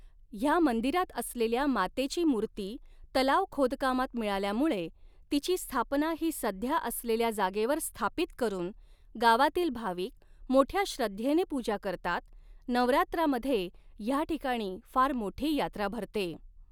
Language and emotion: Marathi, neutral